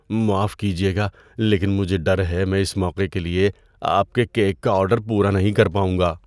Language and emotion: Urdu, fearful